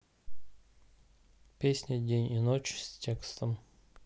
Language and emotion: Russian, neutral